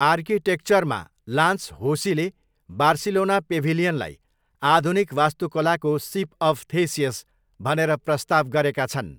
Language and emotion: Nepali, neutral